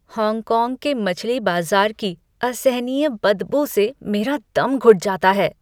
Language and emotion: Hindi, disgusted